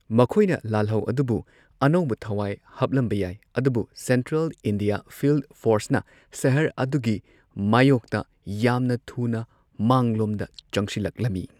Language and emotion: Manipuri, neutral